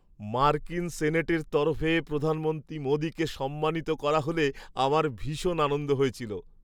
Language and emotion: Bengali, happy